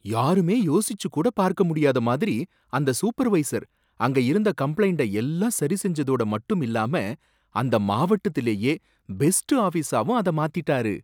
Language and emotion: Tamil, surprised